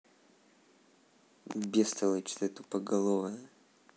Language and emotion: Russian, angry